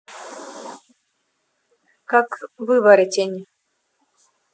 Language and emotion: Russian, neutral